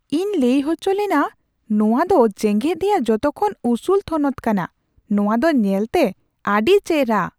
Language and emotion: Santali, surprised